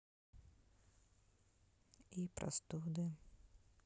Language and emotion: Russian, sad